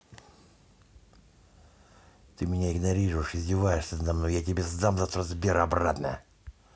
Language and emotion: Russian, angry